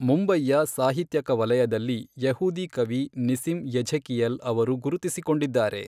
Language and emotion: Kannada, neutral